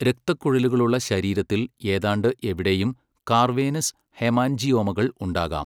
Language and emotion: Malayalam, neutral